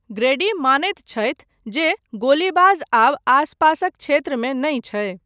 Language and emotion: Maithili, neutral